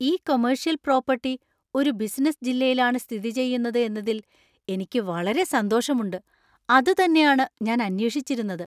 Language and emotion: Malayalam, surprised